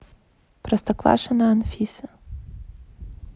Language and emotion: Russian, neutral